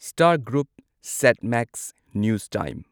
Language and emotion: Manipuri, neutral